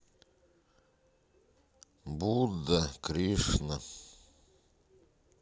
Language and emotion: Russian, sad